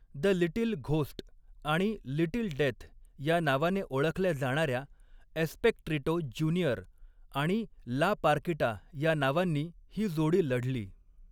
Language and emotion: Marathi, neutral